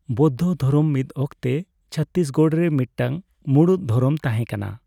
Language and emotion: Santali, neutral